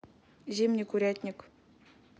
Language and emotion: Russian, neutral